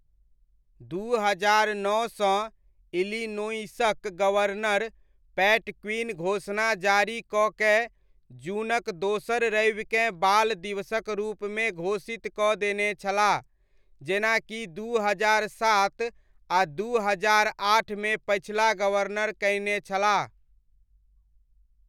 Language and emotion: Maithili, neutral